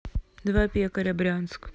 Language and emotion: Russian, neutral